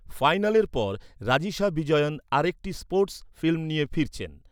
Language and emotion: Bengali, neutral